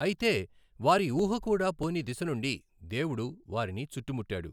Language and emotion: Telugu, neutral